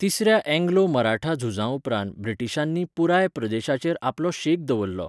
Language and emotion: Goan Konkani, neutral